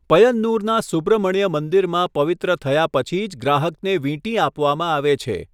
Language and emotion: Gujarati, neutral